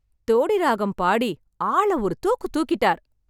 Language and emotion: Tamil, happy